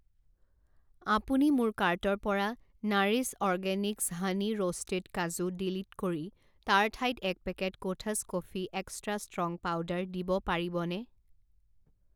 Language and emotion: Assamese, neutral